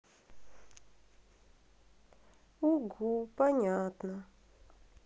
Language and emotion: Russian, sad